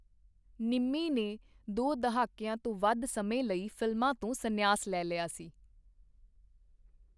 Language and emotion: Punjabi, neutral